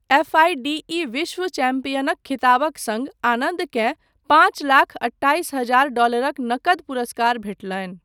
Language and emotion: Maithili, neutral